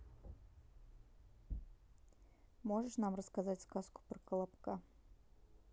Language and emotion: Russian, neutral